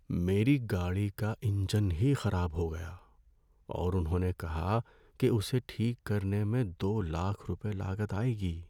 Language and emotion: Urdu, sad